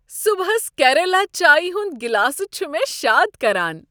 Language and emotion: Kashmiri, happy